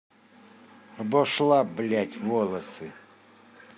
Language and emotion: Russian, angry